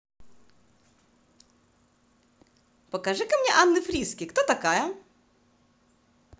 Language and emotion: Russian, positive